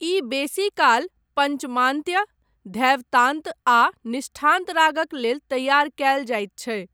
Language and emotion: Maithili, neutral